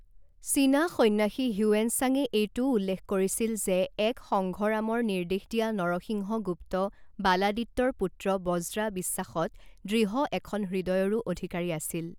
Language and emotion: Assamese, neutral